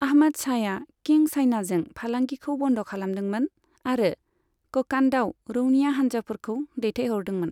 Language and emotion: Bodo, neutral